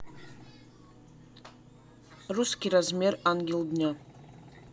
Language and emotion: Russian, neutral